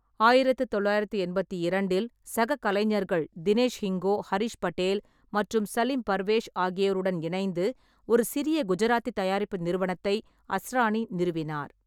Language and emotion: Tamil, neutral